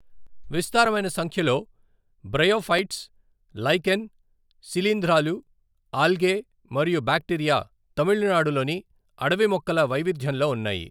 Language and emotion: Telugu, neutral